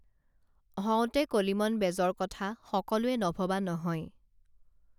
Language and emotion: Assamese, neutral